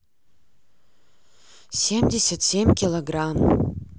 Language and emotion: Russian, sad